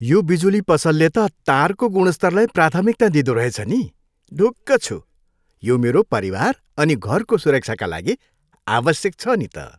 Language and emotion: Nepali, happy